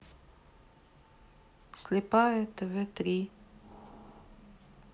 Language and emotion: Russian, sad